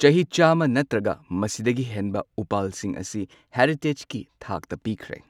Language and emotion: Manipuri, neutral